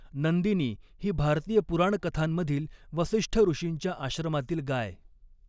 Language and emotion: Marathi, neutral